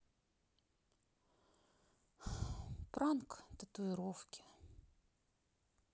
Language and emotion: Russian, sad